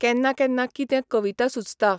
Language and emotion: Goan Konkani, neutral